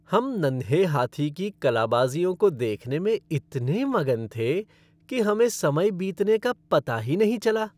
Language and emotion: Hindi, happy